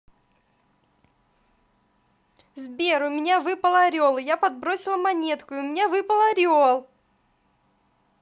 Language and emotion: Russian, positive